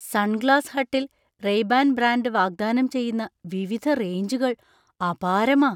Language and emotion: Malayalam, surprised